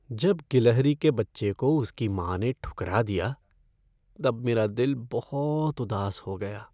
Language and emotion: Hindi, sad